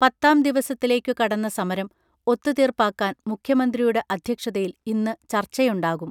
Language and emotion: Malayalam, neutral